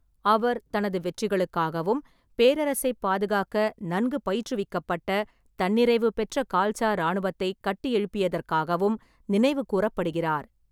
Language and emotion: Tamil, neutral